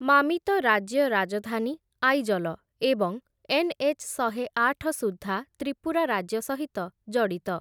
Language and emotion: Odia, neutral